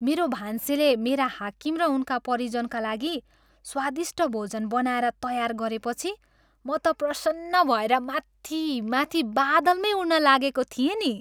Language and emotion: Nepali, happy